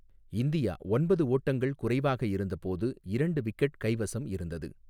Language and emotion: Tamil, neutral